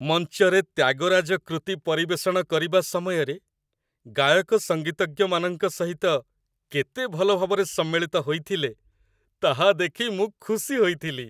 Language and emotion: Odia, happy